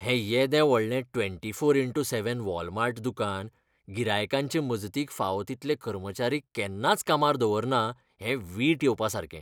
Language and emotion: Goan Konkani, disgusted